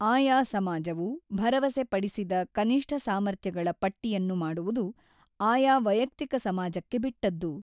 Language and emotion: Kannada, neutral